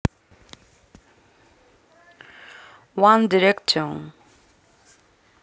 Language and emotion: Russian, neutral